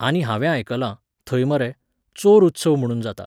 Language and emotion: Goan Konkani, neutral